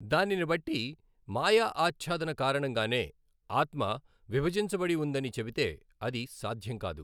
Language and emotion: Telugu, neutral